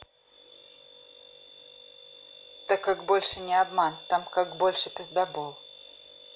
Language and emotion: Russian, neutral